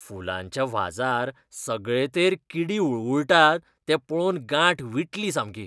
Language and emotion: Goan Konkani, disgusted